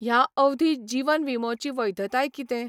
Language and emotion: Goan Konkani, neutral